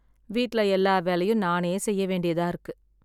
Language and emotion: Tamil, sad